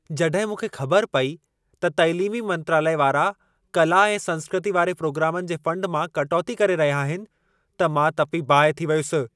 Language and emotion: Sindhi, angry